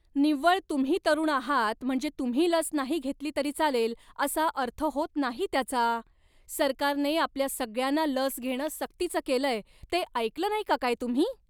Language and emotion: Marathi, angry